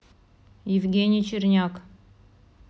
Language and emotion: Russian, neutral